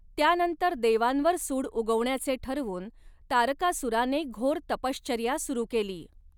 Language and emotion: Marathi, neutral